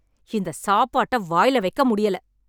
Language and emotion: Tamil, angry